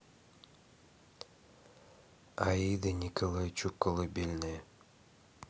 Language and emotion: Russian, neutral